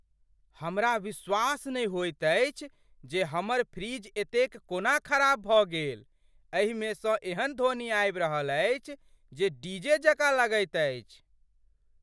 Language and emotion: Maithili, surprised